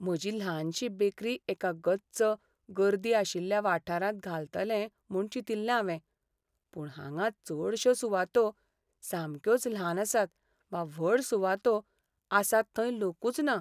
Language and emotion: Goan Konkani, sad